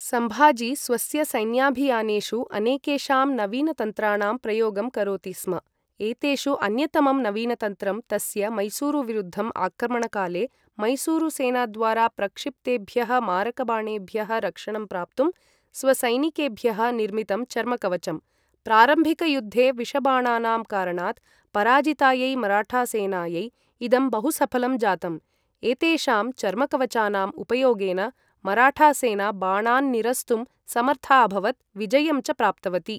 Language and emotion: Sanskrit, neutral